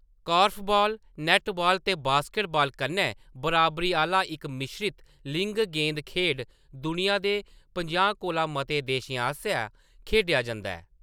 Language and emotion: Dogri, neutral